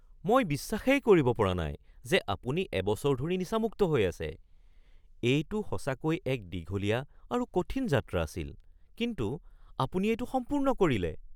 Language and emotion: Assamese, surprised